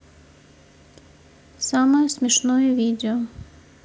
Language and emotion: Russian, neutral